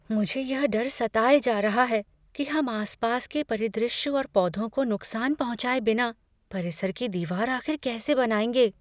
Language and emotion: Hindi, fearful